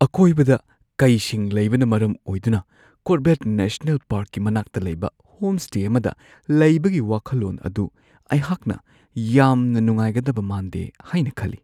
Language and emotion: Manipuri, fearful